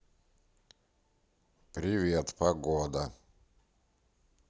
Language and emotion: Russian, neutral